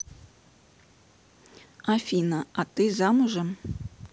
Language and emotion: Russian, neutral